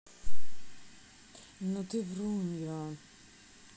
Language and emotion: Russian, neutral